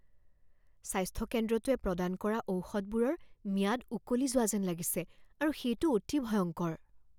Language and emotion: Assamese, fearful